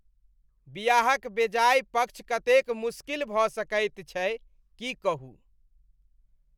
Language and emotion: Maithili, disgusted